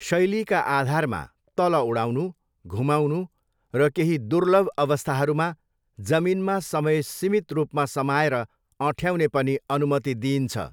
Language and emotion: Nepali, neutral